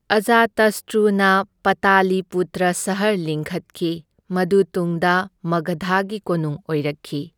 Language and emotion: Manipuri, neutral